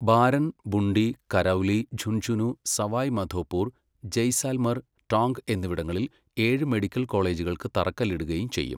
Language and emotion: Malayalam, neutral